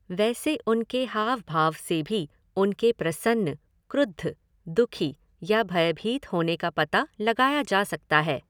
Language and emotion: Hindi, neutral